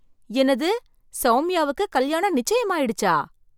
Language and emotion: Tamil, surprised